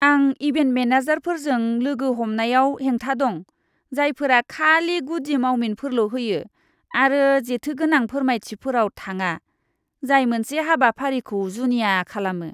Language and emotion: Bodo, disgusted